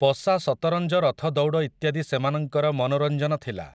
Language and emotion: Odia, neutral